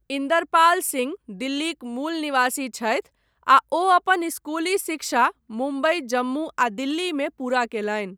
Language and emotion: Maithili, neutral